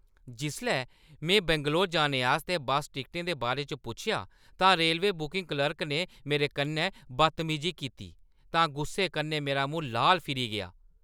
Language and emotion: Dogri, angry